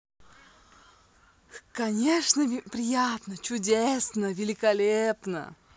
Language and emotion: Russian, positive